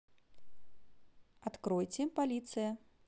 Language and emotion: Russian, positive